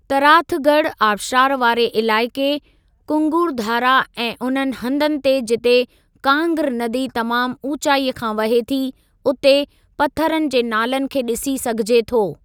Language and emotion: Sindhi, neutral